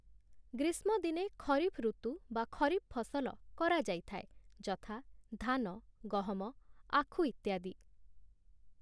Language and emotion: Odia, neutral